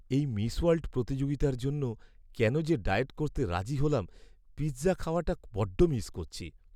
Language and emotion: Bengali, sad